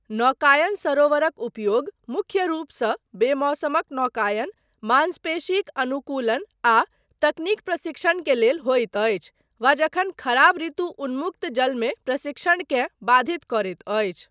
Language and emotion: Maithili, neutral